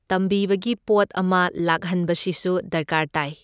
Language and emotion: Manipuri, neutral